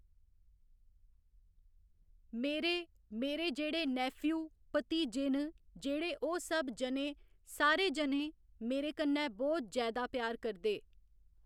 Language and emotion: Dogri, neutral